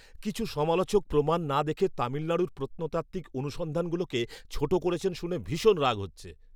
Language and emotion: Bengali, angry